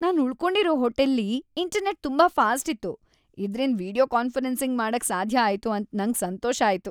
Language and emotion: Kannada, happy